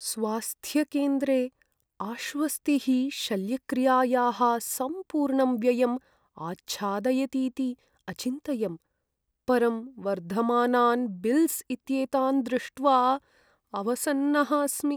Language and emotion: Sanskrit, sad